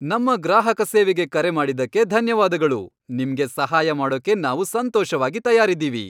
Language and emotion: Kannada, happy